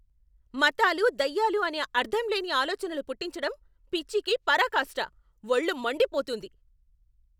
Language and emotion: Telugu, angry